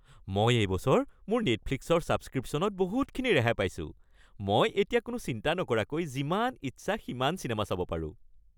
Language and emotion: Assamese, happy